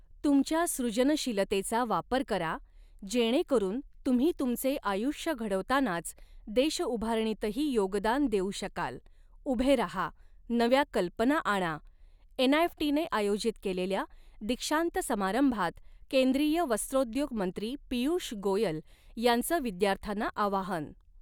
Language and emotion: Marathi, neutral